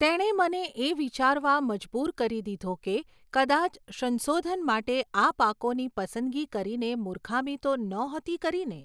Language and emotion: Gujarati, neutral